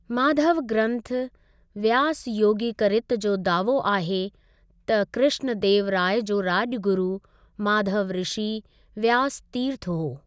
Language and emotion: Sindhi, neutral